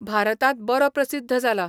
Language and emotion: Goan Konkani, neutral